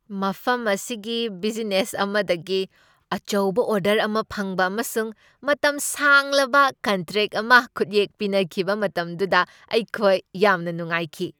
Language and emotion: Manipuri, happy